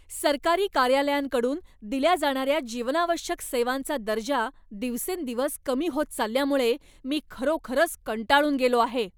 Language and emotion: Marathi, angry